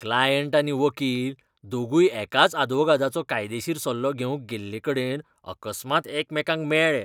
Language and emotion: Goan Konkani, disgusted